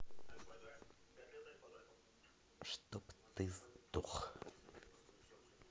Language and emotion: Russian, angry